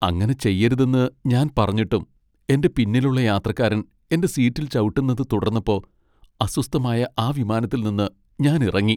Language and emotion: Malayalam, sad